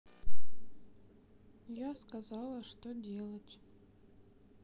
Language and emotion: Russian, sad